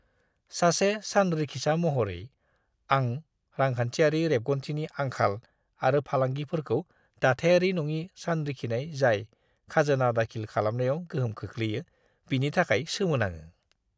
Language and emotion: Bodo, disgusted